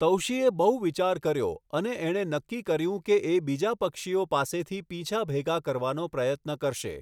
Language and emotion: Gujarati, neutral